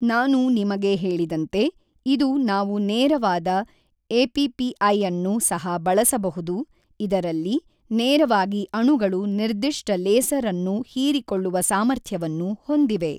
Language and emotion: Kannada, neutral